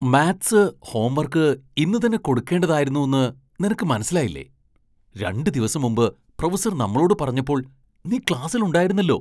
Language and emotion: Malayalam, surprised